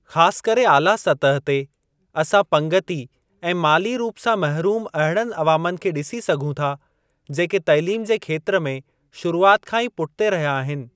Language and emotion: Sindhi, neutral